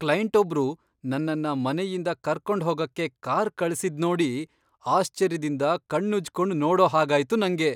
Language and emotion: Kannada, surprised